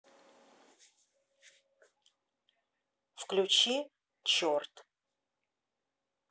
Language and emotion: Russian, neutral